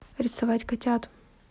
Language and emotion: Russian, neutral